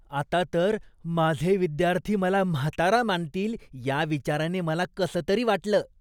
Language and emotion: Marathi, disgusted